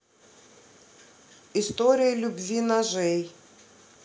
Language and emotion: Russian, neutral